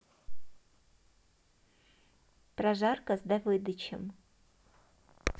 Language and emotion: Russian, neutral